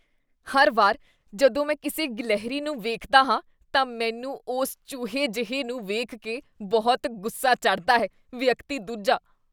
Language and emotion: Punjabi, disgusted